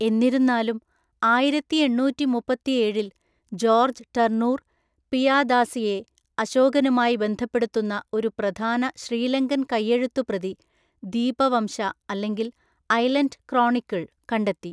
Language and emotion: Malayalam, neutral